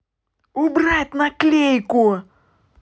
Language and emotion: Russian, angry